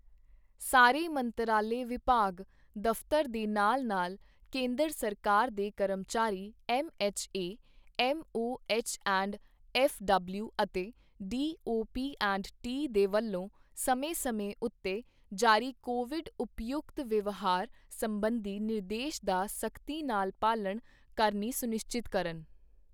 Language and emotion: Punjabi, neutral